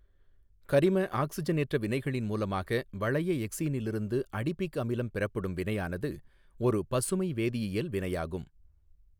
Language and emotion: Tamil, neutral